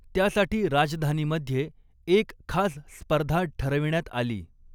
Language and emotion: Marathi, neutral